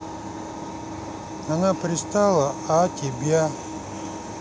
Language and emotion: Russian, neutral